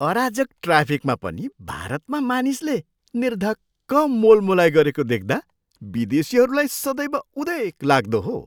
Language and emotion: Nepali, surprised